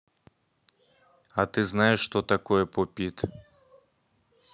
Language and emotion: Russian, neutral